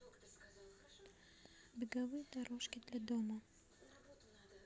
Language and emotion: Russian, neutral